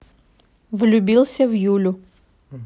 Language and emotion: Russian, neutral